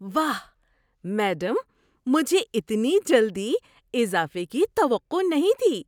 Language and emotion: Urdu, surprised